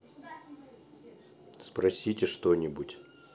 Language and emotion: Russian, neutral